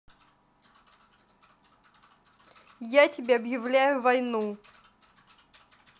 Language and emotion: Russian, angry